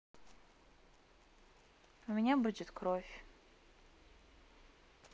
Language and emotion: Russian, sad